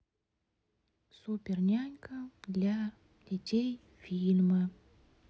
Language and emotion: Russian, neutral